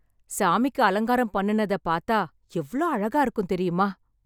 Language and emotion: Tamil, happy